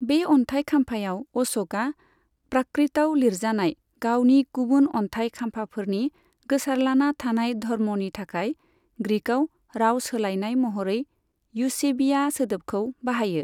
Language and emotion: Bodo, neutral